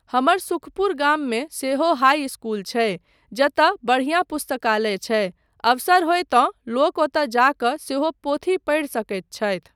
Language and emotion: Maithili, neutral